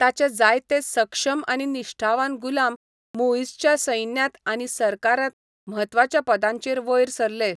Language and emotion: Goan Konkani, neutral